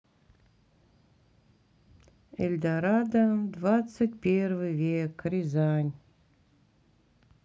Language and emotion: Russian, sad